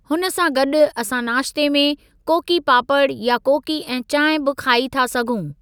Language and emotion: Sindhi, neutral